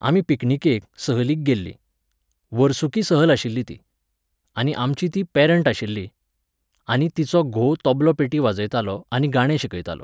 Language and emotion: Goan Konkani, neutral